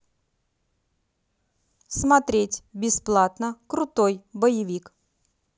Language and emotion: Russian, neutral